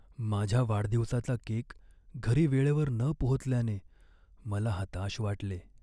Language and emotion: Marathi, sad